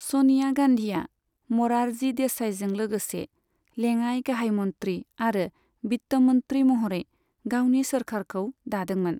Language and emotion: Bodo, neutral